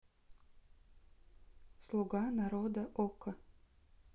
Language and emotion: Russian, neutral